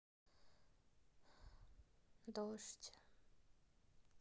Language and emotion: Russian, neutral